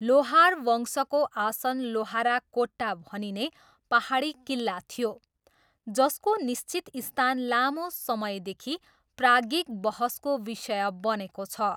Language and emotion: Nepali, neutral